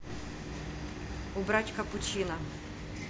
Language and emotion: Russian, neutral